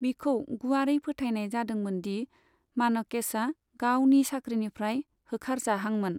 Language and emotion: Bodo, neutral